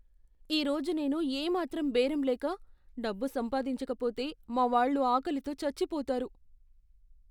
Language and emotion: Telugu, fearful